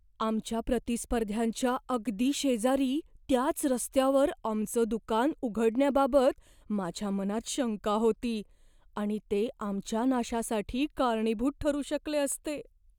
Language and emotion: Marathi, fearful